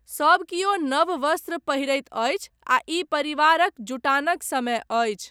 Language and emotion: Maithili, neutral